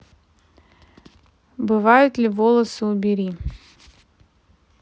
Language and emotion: Russian, neutral